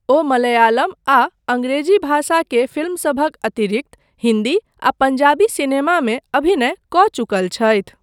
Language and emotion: Maithili, neutral